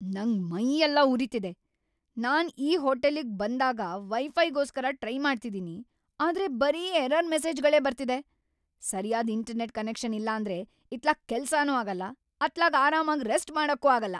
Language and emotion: Kannada, angry